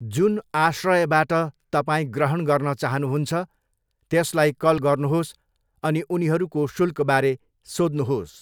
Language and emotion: Nepali, neutral